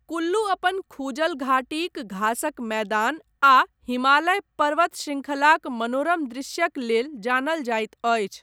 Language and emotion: Maithili, neutral